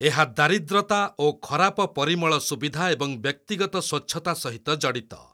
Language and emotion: Odia, neutral